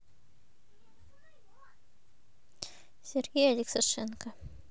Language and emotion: Russian, neutral